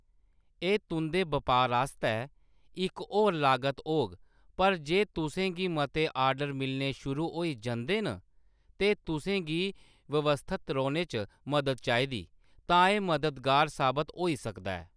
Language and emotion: Dogri, neutral